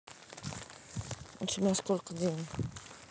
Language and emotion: Russian, neutral